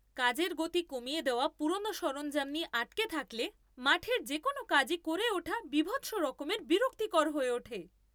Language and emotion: Bengali, angry